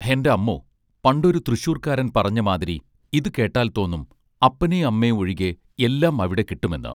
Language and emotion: Malayalam, neutral